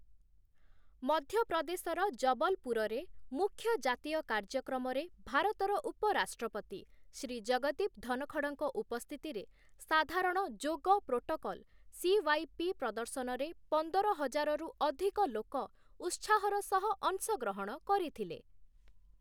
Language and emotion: Odia, neutral